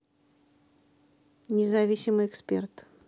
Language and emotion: Russian, neutral